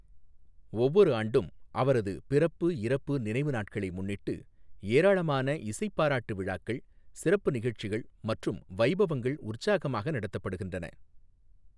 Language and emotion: Tamil, neutral